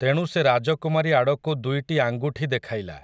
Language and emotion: Odia, neutral